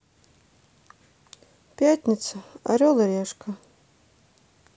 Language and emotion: Russian, sad